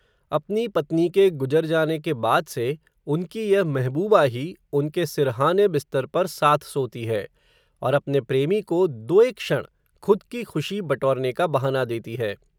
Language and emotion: Hindi, neutral